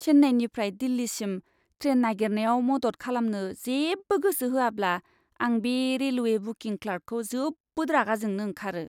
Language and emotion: Bodo, disgusted